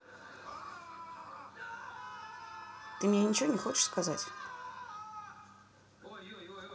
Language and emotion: Russian, angry